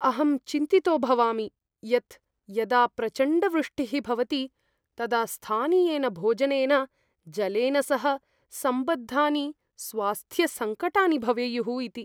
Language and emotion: Sanskrit, fearful